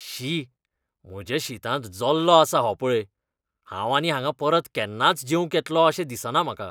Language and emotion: Goan Konkani, disgusted